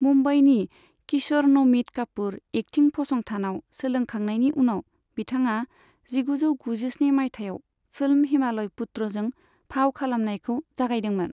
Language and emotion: Bodo, neutral